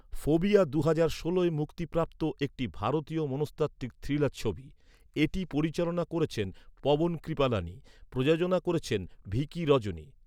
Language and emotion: Bengali, neutral